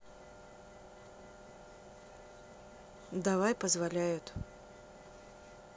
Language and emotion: Russian, neutral